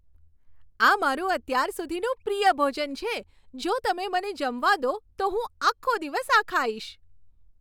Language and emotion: Gujarati, happy